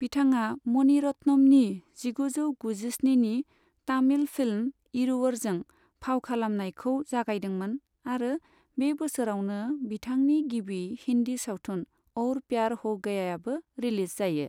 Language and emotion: Bodo, neutral